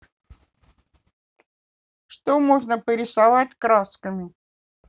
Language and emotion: Russian, neutral